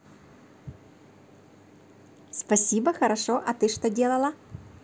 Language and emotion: Russian, positive